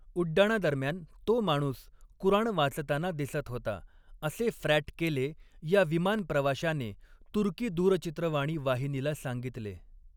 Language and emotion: Marathi, neutral